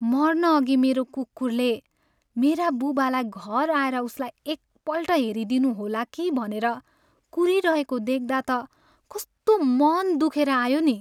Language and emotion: Nepali, sad